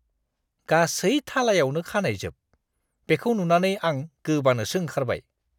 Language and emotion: Bodo, disgusted